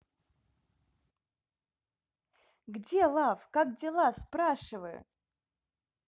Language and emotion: Russian, positive